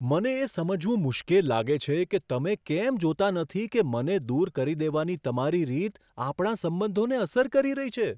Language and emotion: Gujarati, surprised